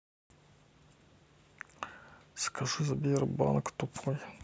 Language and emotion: Russian, neutral